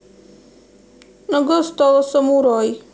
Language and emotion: Russian, sad